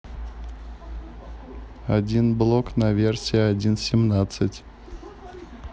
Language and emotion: Russian, neutral